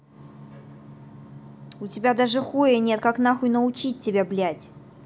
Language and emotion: Russian, angry